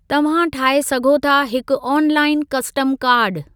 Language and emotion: Sindhi, neutral